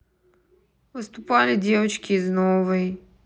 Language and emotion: Russian, neutral